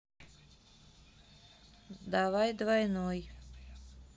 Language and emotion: Russian, neutral